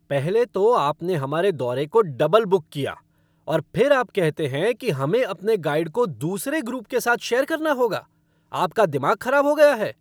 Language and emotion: Hindi, angry